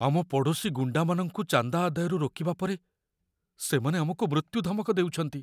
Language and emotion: Odia, fearful